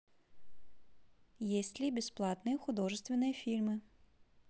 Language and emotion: Russian, neutral